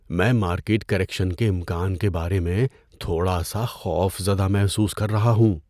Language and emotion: Urdu, fearful